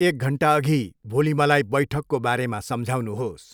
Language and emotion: Nepali, neutral